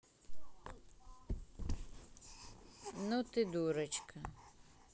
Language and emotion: Russian, neutral